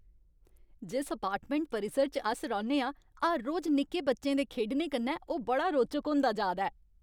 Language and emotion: Dogri, happy